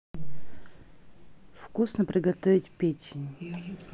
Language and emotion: Russian, neutral